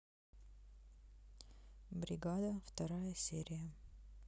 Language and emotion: Russian, neutral